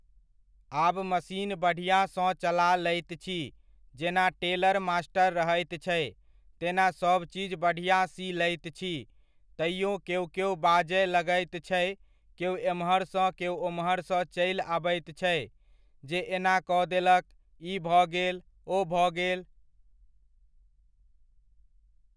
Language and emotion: Maithili, neutral